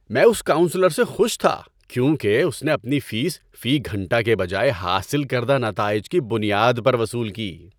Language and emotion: Urdu, happy